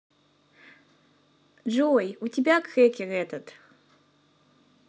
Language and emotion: Russian, positive